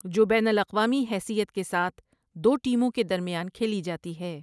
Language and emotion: Urdu, neutral